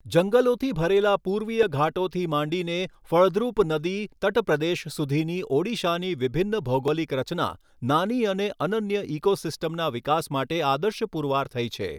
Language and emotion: Gujarati, neutral